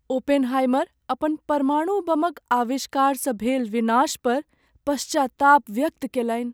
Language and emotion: Maithili, sad